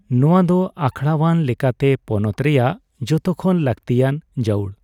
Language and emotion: Santali, neutral